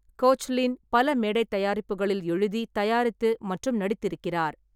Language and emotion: Tamil, neutral